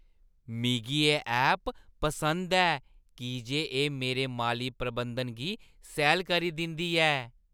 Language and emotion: Dogri, happy